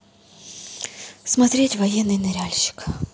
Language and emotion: Russian, sad